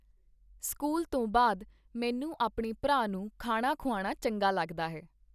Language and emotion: Punjabi, neutral